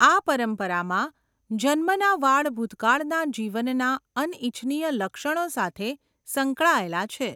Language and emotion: Gujarati, neutral